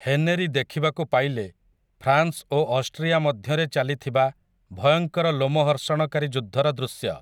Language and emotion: Odia, neutral